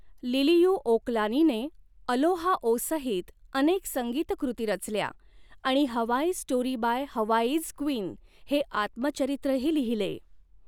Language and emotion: Marathi, neutral